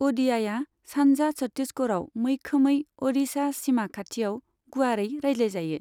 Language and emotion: Bodo, neutral